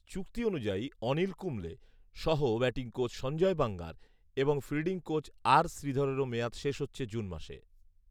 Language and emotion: Bengali, neutral